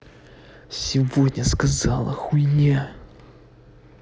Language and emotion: Russian, angry